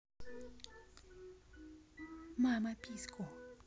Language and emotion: Russian, neutral